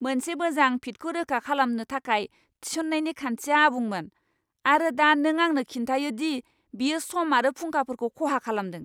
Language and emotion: Bodo, angry